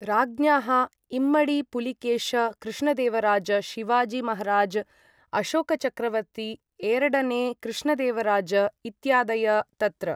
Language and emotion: Sanskrit, neutral